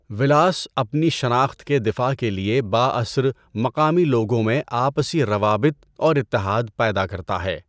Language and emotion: Urdu, neutral